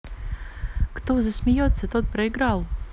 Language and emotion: Russian, positive